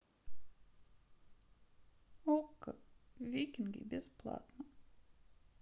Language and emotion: Russian, sad